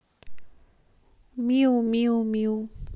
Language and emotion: Russian, neutral